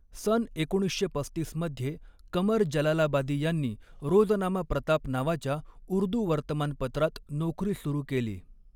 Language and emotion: Marathi, neutral